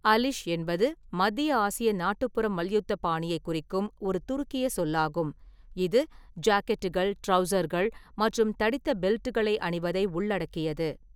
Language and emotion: Tamil, neutral